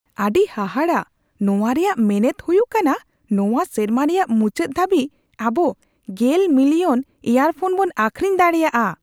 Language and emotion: Santali, surprised